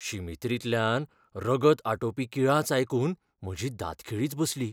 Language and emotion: Goan Konkani, fearful